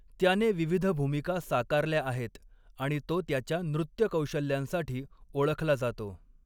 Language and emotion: Marathi, neutral